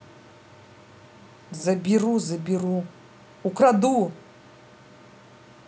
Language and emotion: Russian, angry